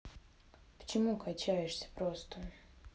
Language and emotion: Russian, neutral